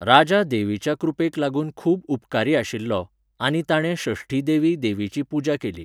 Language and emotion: Goan Konkani, neutral